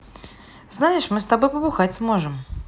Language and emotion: Russian, positive